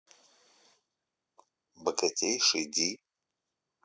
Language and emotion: Russian, neutral